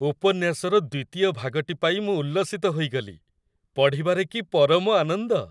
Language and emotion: Odia, happy